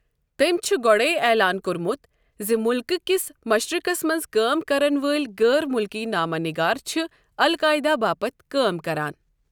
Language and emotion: Kashmiri, neutral